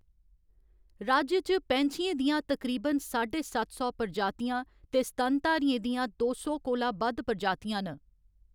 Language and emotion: Dogri, neutral